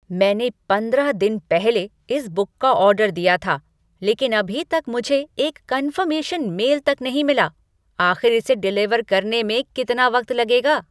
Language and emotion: Hindi, angry